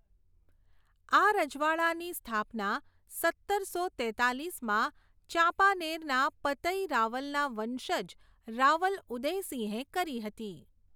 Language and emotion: Gujarati, neutral